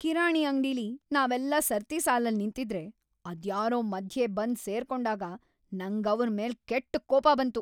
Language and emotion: Kannada, angry